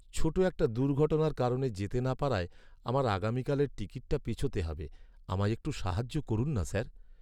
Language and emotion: Bengali, sad